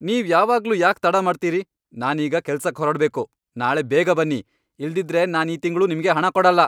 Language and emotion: Kannada, angry